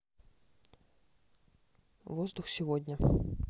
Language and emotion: Russian, neutral